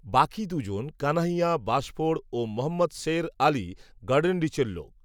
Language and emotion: Bengali, neutral